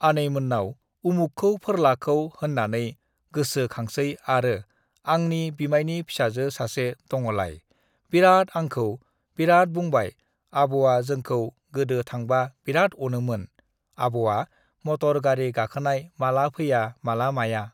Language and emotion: Bodo, neutral